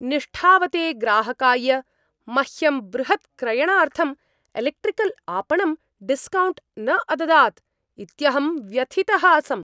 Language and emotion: Sanskrit, angry